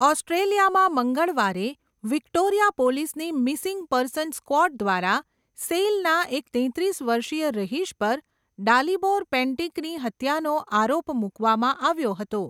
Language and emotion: Gujarati, neutral